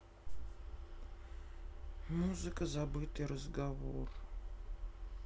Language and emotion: Russian, sad